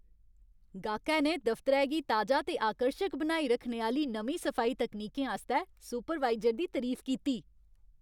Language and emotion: Dogri, happy